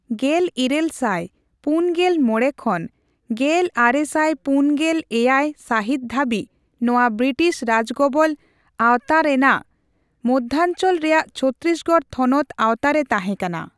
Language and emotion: Santali, neutral